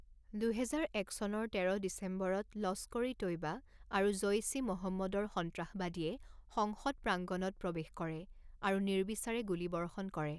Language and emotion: Assamese, neutral